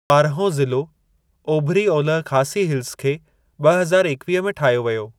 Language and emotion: Sindhi, neutral